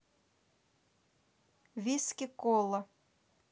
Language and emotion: Russian, neutral